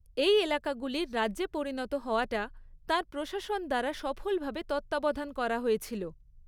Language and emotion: Bengali, neutral